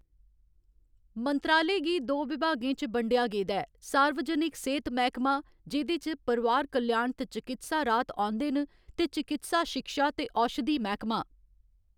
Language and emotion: Dogri, neutral